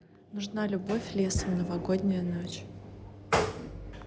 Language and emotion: Russian, neutral